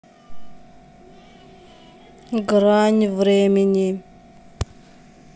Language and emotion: Russian, neutral